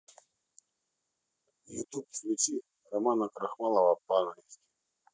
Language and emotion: Russian, neutral